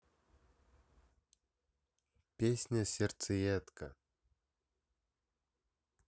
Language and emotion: Russian, neutral